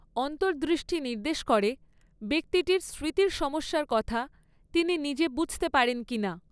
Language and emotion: Bengali, neutral